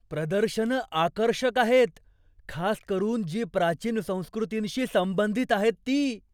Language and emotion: Marathi, surprised